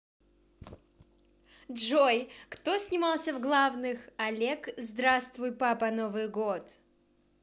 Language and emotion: Russian, neutral